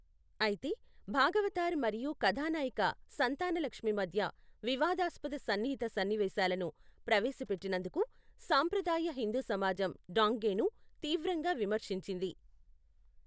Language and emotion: Telugu, neutral